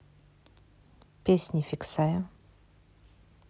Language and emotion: Russian, neutral